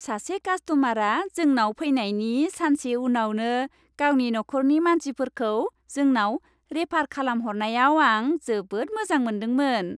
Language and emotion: Bodo, happy